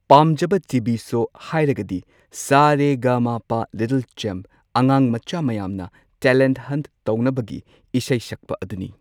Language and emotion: Manipuri, neutral